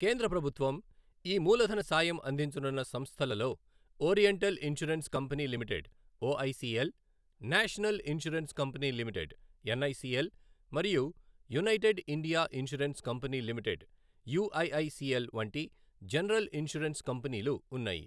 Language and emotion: Telugu, neutral